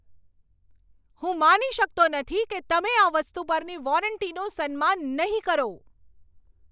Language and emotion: Gujarati, angry